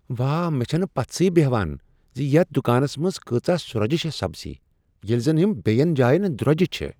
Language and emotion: Kashmiri, surprised